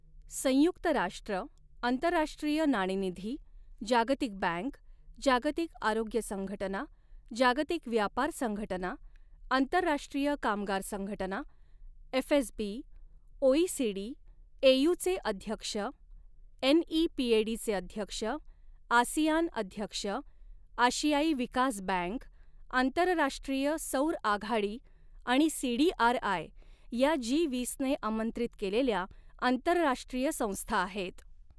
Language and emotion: Marathi, neutral